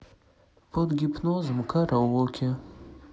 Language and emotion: Russian, sad